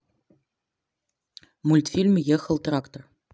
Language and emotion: Russian, neutral